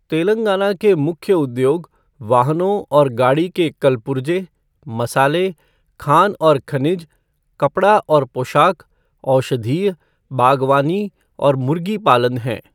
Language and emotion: Hindi, neutral